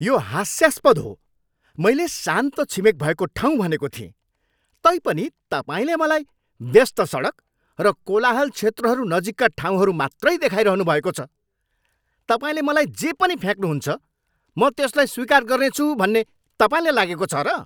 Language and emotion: Nepali, angry